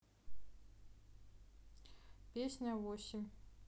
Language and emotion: Russian, neutral